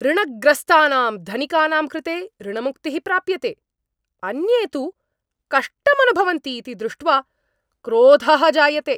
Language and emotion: Sanskrit, angry